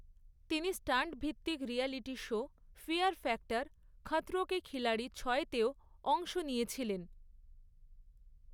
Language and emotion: Bengali, neutral